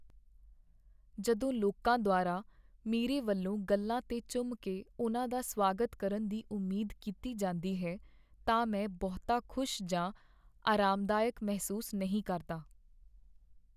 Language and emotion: Punjabi, sad